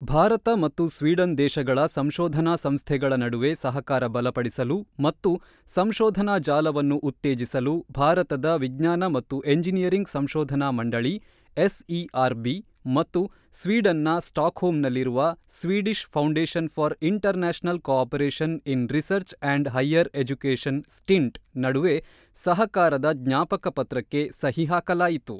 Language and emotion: Kannada, neutral